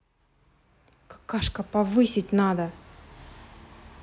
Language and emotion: Russian, angry